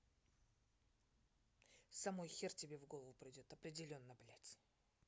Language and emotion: Russian, angry